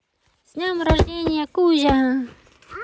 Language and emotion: Russian, positive